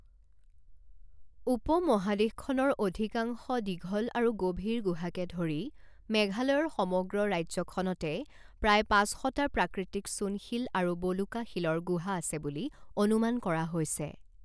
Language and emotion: Assamese, neutral